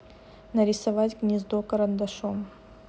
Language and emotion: Russian, neutral